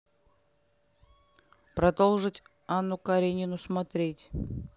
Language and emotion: Russian, neutral